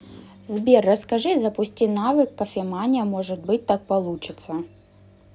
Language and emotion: Russian, neutral